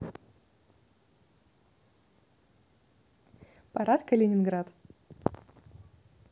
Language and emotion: Russian, neutral